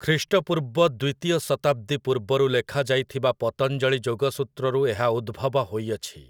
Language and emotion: Odia, neutral